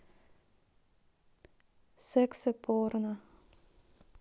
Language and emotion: Russian, neutral